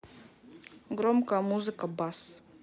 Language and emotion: Russian, neutral